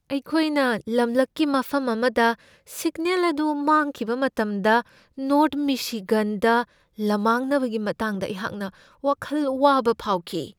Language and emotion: Manipuri, fearful